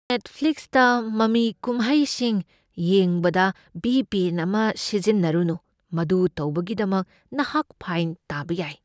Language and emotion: Manipuri, fearful